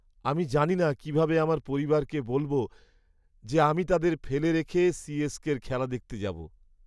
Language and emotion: Bengali, sad